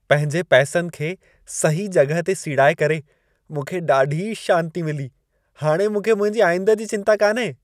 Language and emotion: Sindhi, happy